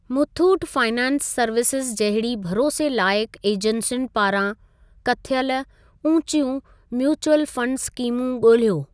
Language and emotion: Sindhi, neutral